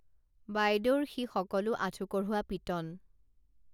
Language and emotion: Assamese, neutral